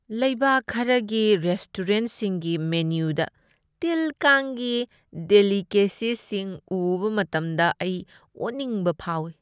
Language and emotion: Manipuri, disgusted